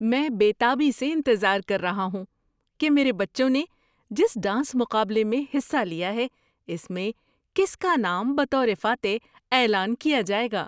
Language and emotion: Urdu, surprised